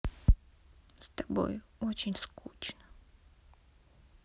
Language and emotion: Russian, sad